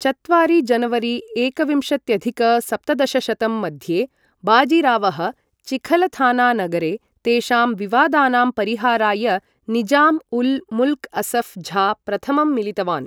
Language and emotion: Sanskrit, neutral